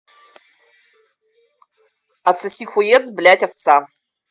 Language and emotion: Russian, neutral